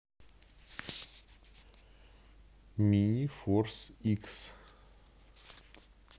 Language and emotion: Russian, neutral